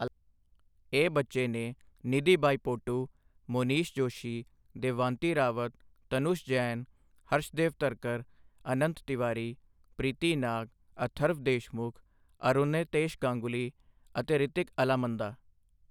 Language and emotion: Punjabi, neutral